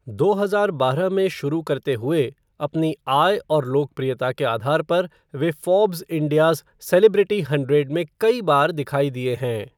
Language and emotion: Hindi, neutral